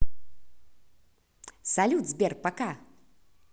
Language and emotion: Russian, positive